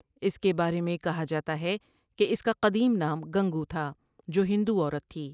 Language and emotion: Urdu, neutral